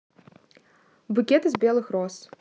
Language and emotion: Russian, neutral